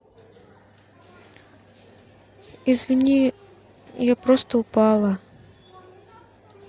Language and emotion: Russian, sad